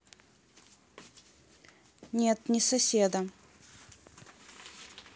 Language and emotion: Russian, neutral